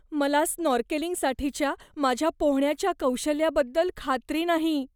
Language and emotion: Marathi, fearful